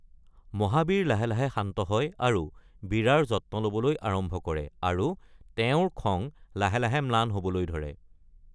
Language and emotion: Assamese, neutral